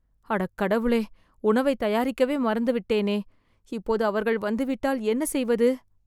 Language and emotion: Tamil, fearful